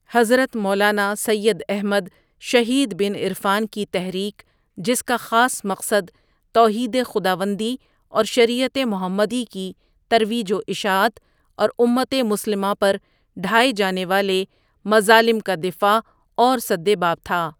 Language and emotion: Urdu, neutral